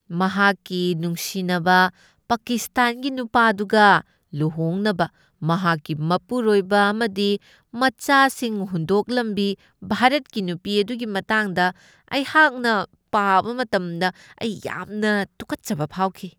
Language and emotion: Manipuri, disgusted